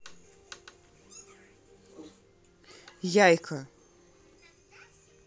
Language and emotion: Russian, neutral